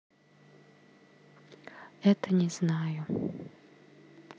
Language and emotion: Russian, sad